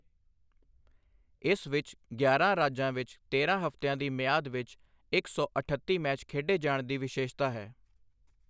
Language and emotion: Punjabi, neutral